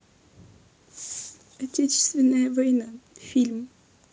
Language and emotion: Russian, sad